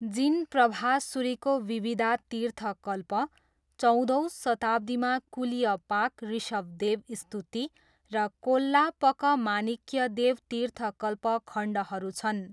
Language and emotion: Nepali, neutral